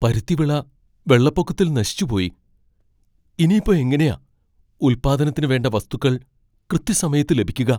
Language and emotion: Malayalam, fearful